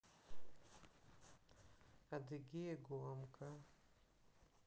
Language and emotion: Russian, neutral